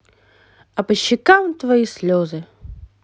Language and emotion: Russian, positive